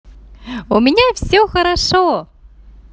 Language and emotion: Russian, positive